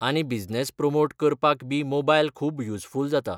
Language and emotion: Goan Konkani, neutral